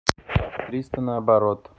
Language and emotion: Russian, neutral